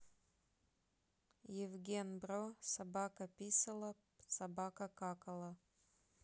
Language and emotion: Russian, neutral